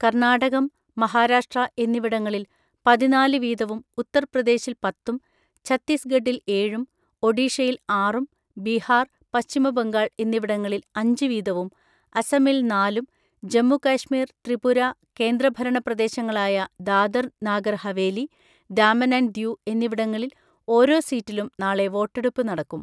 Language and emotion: Malayalam, neutral